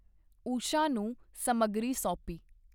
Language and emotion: Punjabi, neutral